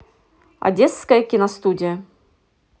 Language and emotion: Russian, positive